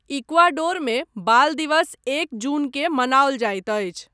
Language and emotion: Maithili, neutral